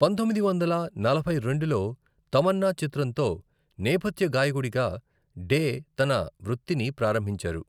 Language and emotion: Telugu, neutral